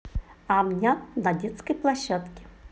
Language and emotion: Russian, positive